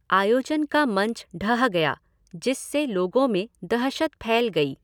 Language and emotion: Hindi, neutral